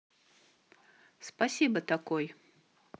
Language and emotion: Russian, neutral